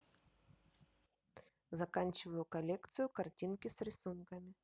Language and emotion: Russian, neutral